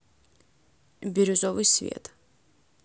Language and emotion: Russian, neutral